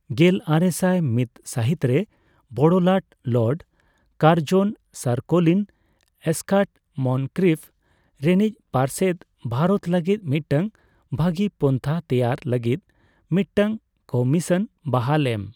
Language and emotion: Santali, neutral